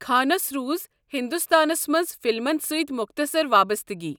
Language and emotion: Kashmiri, neutral